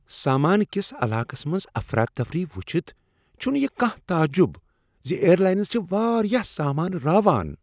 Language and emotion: Kashmiri, disgusted